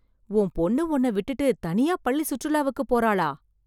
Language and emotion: Tamil, surprised